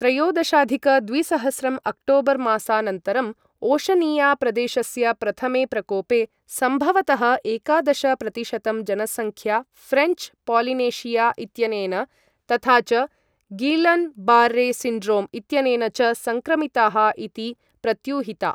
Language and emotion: Sanskrit, neutral